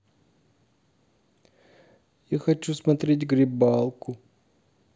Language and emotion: Russian, sad